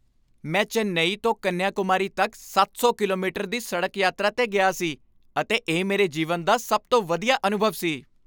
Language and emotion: Punjabi, happy